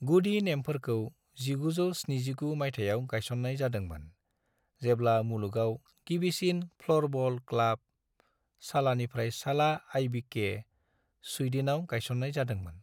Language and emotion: Bodo, neutral